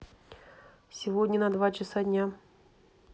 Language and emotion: Russian, neutral